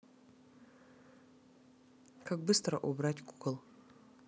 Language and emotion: Russian, neutral